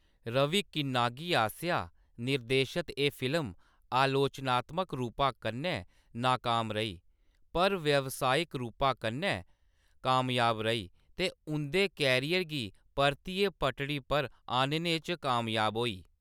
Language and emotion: Dogri, neutral